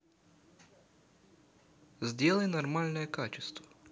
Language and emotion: Russian, neutral